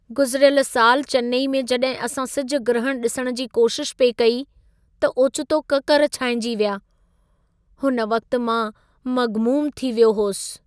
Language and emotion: Sindhi, sad